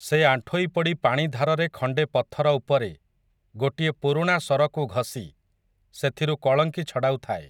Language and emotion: Odia, neutral